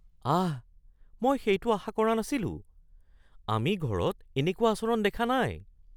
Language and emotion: Assamese, surprised